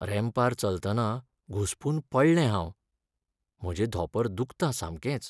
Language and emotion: Goan Konkani, sad